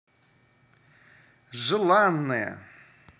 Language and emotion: Russian, positive